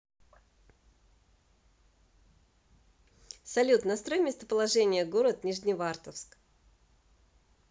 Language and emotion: Russian, positive